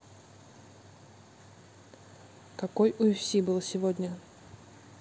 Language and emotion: Russian, neutral